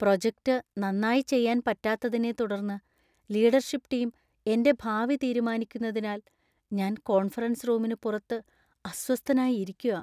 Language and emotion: Malayalam, fearful